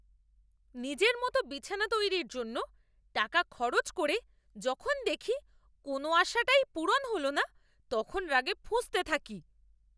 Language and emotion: Bengali, angry